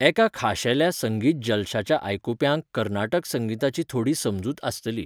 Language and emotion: Goan Konkani, neutral